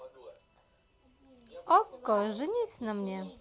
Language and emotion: Russian, positive